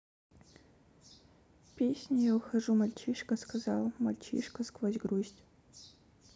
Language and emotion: Russian, sad